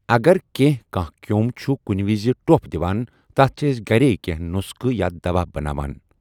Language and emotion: Kashmiri, neutral